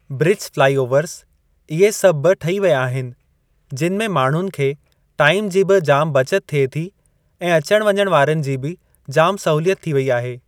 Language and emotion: Sindhi, neutral